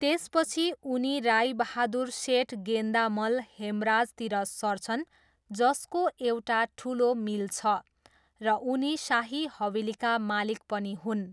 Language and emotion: Nepali, neutral